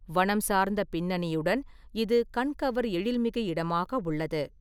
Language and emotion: Tamil, neutral